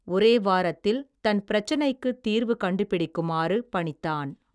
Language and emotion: Tamil, neutral